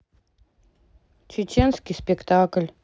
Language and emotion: Russian, sad